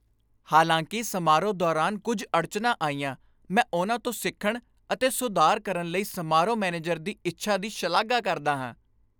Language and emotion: Punjabi, happy